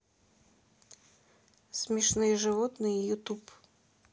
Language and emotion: Russian, neutral